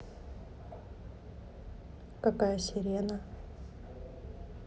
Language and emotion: Russian, neutral